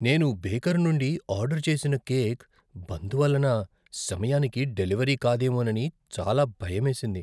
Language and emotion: Telugu, fearful